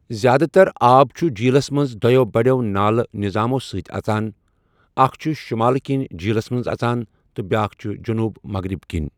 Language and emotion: Kashmiri, neutral